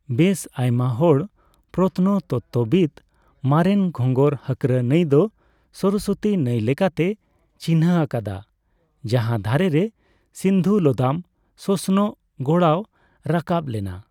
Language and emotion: Santali, neutral